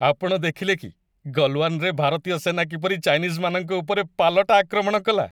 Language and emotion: Odia, happy